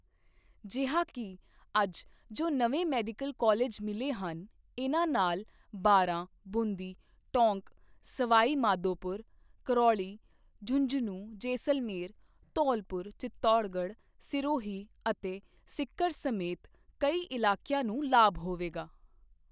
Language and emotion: Punjabi, neutral